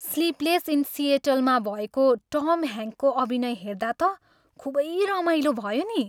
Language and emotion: Nepali, happy